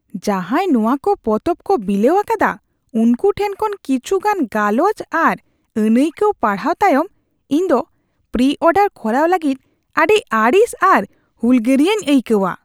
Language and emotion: Santali, disgusted